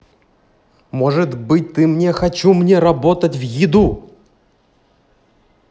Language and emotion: Russian, angry